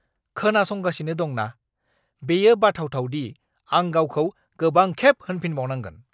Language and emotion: Bodo, angry